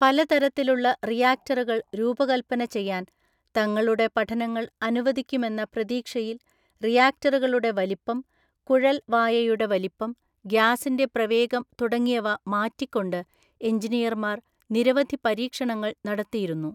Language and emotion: Malayalam, neutral